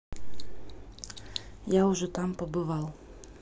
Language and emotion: Russian, neutral